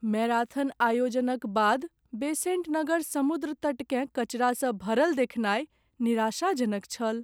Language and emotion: Maithili, sad